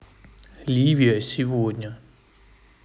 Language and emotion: Russian, neutral